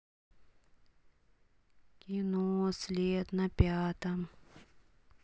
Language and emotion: Russian, sad